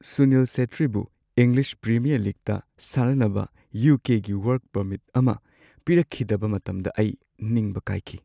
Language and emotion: Manipuri, sad